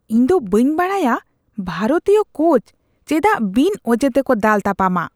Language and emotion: Santali, disgusted